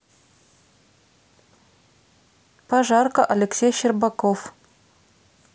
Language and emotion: Russian, neutral